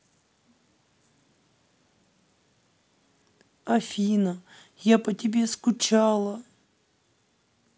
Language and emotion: Russian, sad